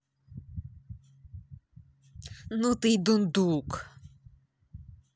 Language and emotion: Russian, angry